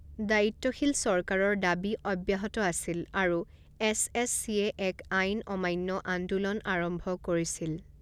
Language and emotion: Assamese, neutral